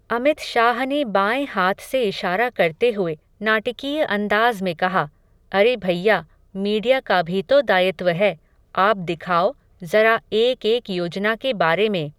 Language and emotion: Hindi, neutral